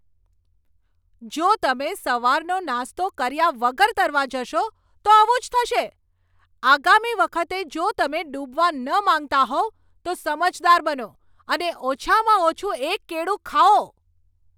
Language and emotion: Gujarati, angry